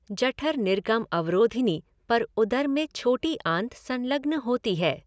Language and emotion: Hindi, neutral